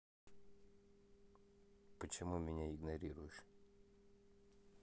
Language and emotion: Russian, neutral